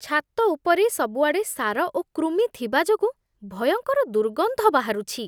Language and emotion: Odia, disgusted